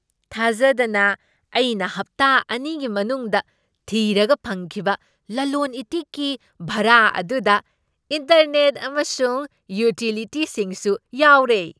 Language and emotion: Manipuri, surprised